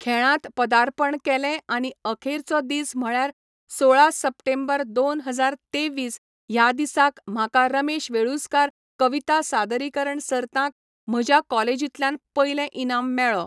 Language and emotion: Goan Konkani, neutral